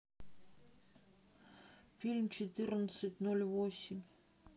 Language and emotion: Russian, neutral